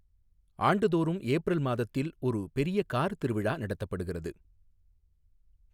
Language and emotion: Tamil, neutral